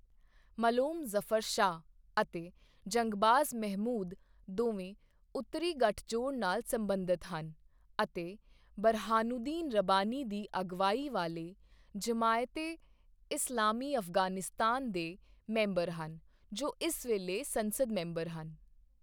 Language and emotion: Punjabi, neutral